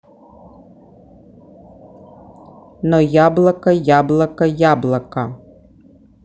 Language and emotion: Russian, neutral